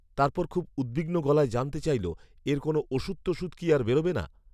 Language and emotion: Bengali, neutral